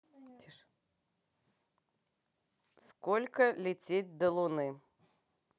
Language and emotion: Russian, neutral